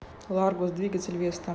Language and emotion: Russian, neutral